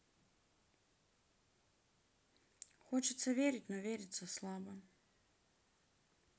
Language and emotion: Russian, sad